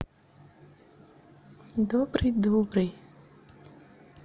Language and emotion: Russian, positive